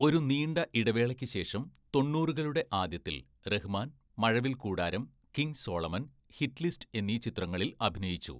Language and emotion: Malayalam, neutral